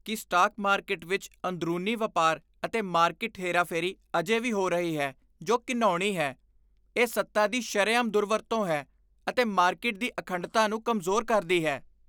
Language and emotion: Punjabi, disgusted